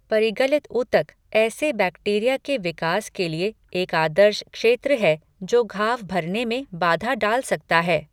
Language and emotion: Hindi, neutral